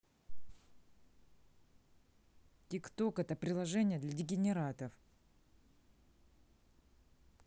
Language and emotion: Russian, neutral